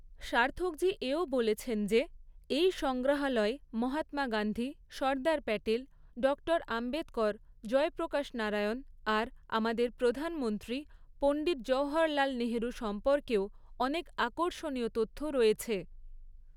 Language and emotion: Bengali, neutral